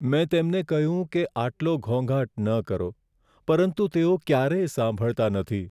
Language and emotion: Gujarati, sad